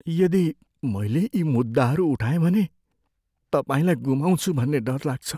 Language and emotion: Nepali, fearful